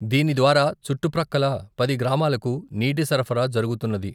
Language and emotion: Telugu, neutral